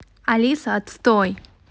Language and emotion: Russian, angry